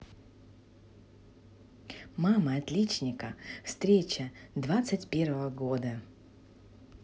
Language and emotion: Russian, positive